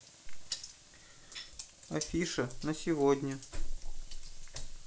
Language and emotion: Russian, neutral